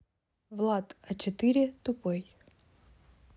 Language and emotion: Russian, neutral